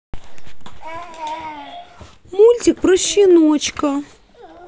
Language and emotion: Russian, sad